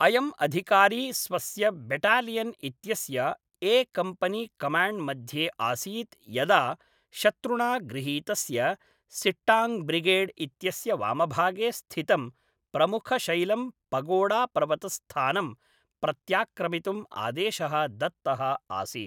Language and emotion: Sanskrit, neutral